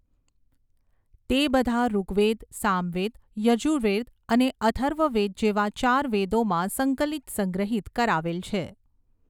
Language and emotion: Gujarati, neutral